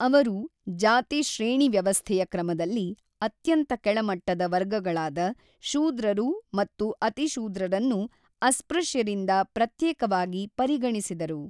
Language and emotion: Kannada, neutral